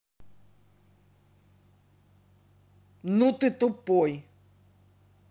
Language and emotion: Russian, angry